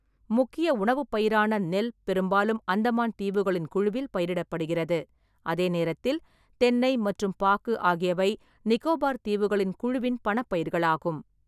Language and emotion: Tamil, neutral